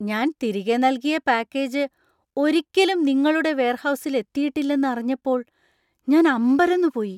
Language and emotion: Malayalam, surprised